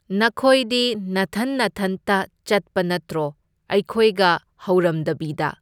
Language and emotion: Manipuri, neutral